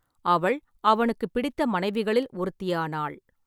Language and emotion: Tamil, neutral